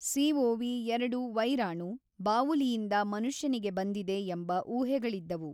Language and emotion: Kannada, neutral